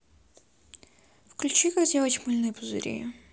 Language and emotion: Russian, neutral